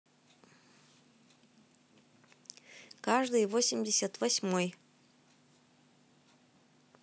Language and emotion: Russian, neutral